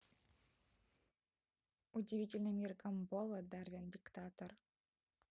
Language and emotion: Russian, neutral